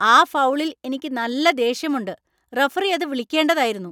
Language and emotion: Malayalam, angry